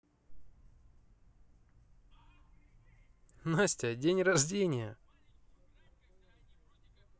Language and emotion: Russian, positive